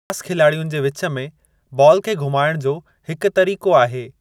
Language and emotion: Sindhi, neutral